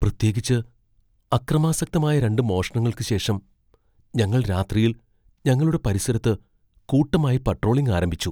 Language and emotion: Malayalam, fearful